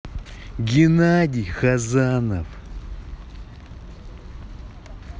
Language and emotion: Russian, angry